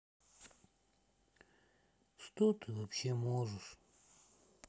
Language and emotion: Russian, sad